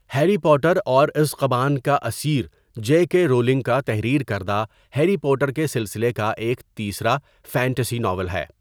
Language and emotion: Urdu, neutral